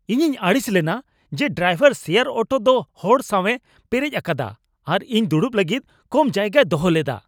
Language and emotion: Santali, angry